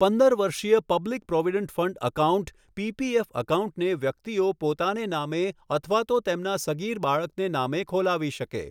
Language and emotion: Gujarati, neutral